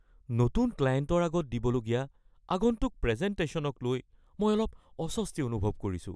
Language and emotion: Assamese, fearful